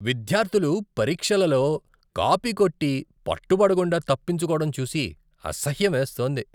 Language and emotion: Telugu, disgusted